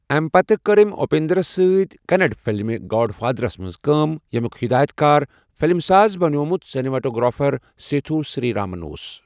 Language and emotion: Kashmiri, neutral